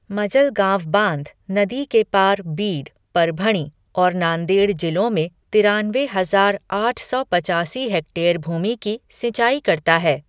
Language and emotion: Hindi, neutral